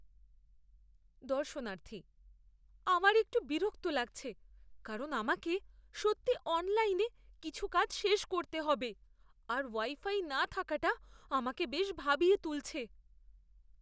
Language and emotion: Bengali, fearful